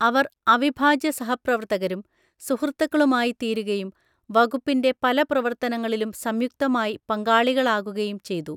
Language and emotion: Malayalam, neutral